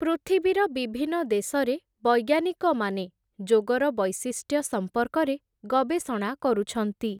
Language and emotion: Odia, neutral